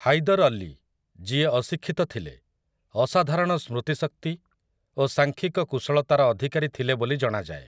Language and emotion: Odia, neutral